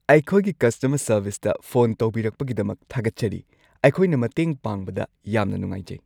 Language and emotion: Manipuri, happy